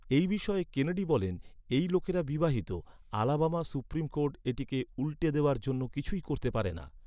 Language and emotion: Bengali, neutral